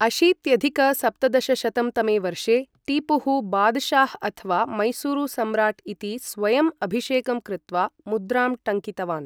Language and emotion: Sanskrit, neutral